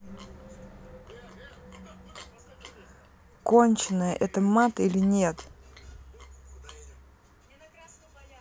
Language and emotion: Russian, neutral